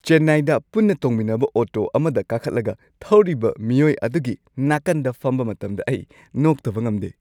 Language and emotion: Manipuri, happy